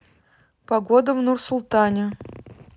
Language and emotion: Russian, neutral